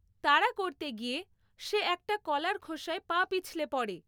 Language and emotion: Bengali, neutral